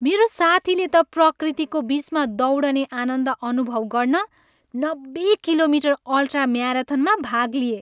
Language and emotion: Nepali, happy